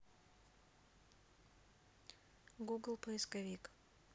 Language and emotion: Russian, neutral